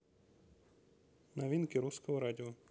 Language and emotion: Russian, neutral